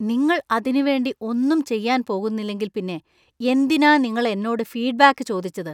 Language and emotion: Malayalam, disgusted